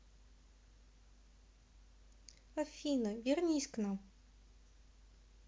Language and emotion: Russian, sad